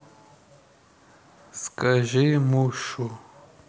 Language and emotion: Russian, neutral